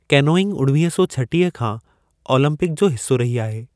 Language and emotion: Sindhi, neutral